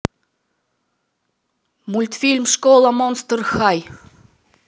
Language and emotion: Russian, positive